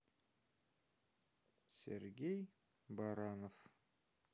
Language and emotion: Russian, sad